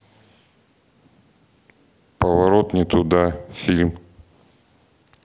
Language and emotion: Russian, neutral